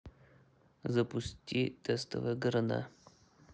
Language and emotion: Russian, neutral